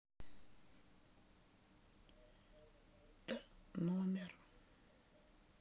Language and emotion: Russian, sad